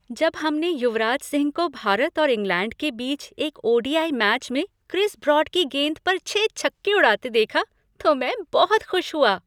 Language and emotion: Hindi, happy